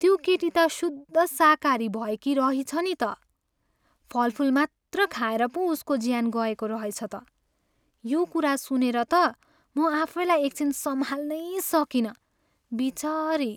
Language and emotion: Nepali, sad